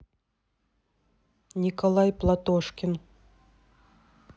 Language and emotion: Russian, neutral